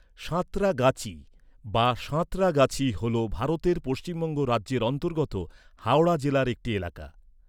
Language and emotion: Bengali, neutral